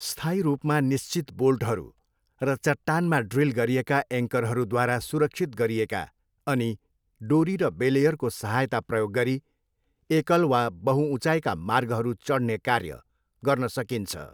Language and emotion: Nepali, neutral